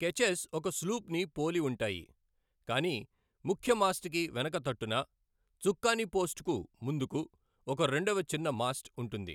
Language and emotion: Telugu, neutral